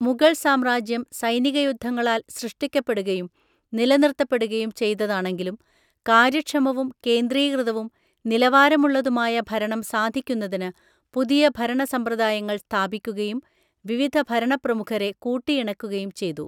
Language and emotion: Malayalam, neutral